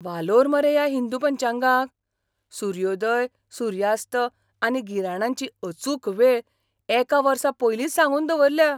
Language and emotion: Goan Konkani, surprised